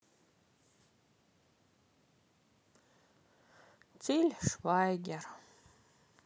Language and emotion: Russian, sad